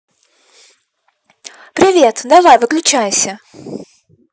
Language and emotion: Russian, neutral